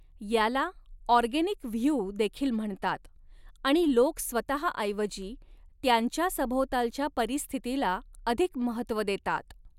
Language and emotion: Marathi, neutral